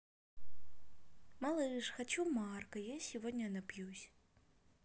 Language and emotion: Russian, neutral